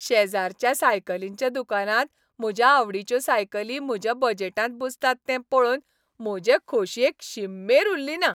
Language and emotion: Goan Konkani, happy